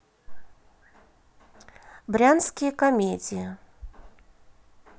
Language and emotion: Russian, neutral